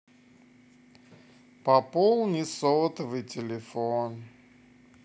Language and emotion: Russian, sad